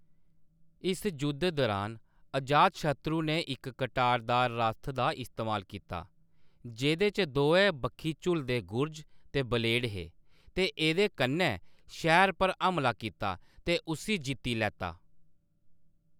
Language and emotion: Dogri, neutral